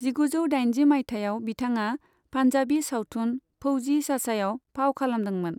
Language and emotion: Bodo, neutral